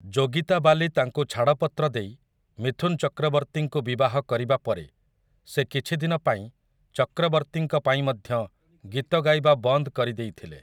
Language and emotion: Odia, neutral